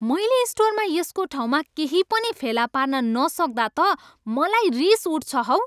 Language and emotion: Nepali, angry